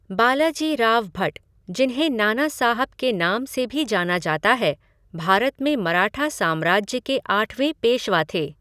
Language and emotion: Hindi, neutral